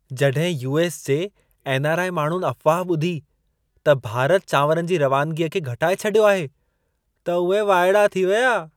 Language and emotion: Sindhi, surprised